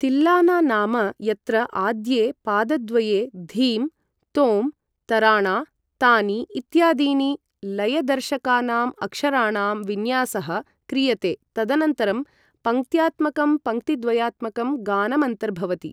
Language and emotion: Sanskrit, neutral